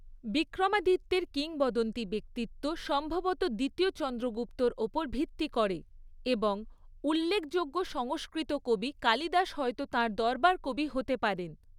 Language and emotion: Bengali, neutral